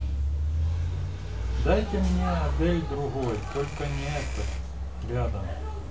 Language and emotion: Russian, neutral